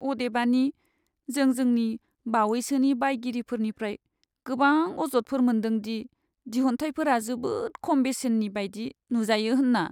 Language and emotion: Bodo, sad